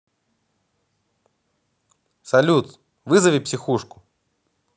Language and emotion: Russian, positive